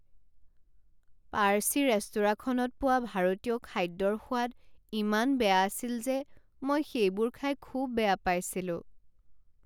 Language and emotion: Assamese, sad